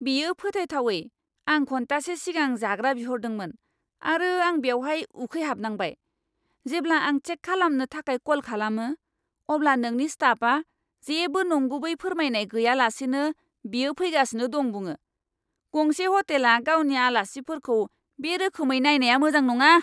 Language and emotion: Bodo, angry